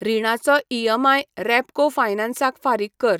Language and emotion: Goan Konkani, neutral